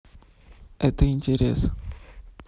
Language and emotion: Russian, neutral